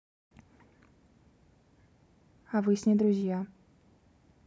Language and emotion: Russian, neutral